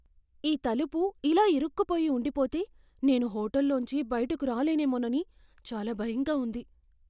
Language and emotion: Telugu, fearful